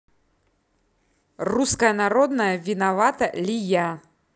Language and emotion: Russian, angry